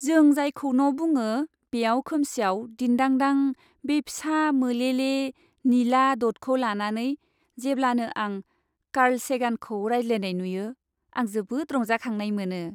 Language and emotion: Bodo, happy